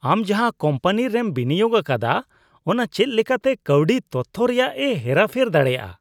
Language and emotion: Santali, disgusted